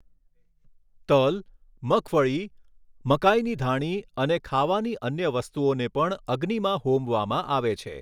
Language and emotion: Gujarati, neutral